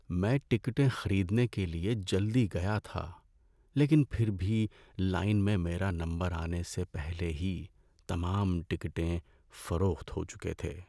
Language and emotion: Urdu, sad